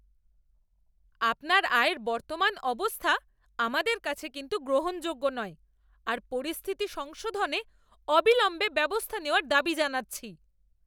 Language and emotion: Bengali, angry